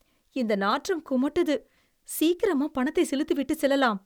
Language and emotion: Tamil, disgusted